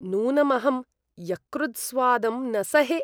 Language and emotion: Sanskrit, disgusted